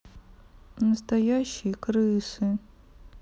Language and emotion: Russian, sad